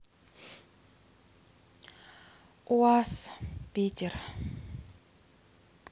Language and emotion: Russian, neutral